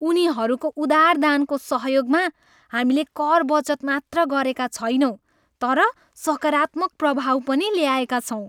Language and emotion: Nepali, happy